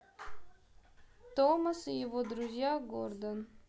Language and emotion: Russian, neutral